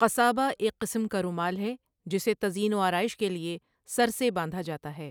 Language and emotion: Urdu, neutral